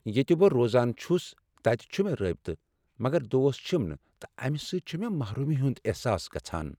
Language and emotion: Kashmiri, sad